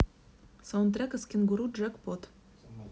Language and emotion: Russian, neutral